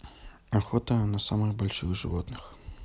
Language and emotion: Russian, neutral